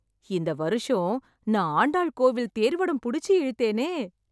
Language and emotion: Tamil, happy